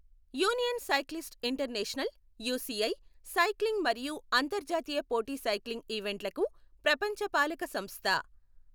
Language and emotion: Telugu, neutral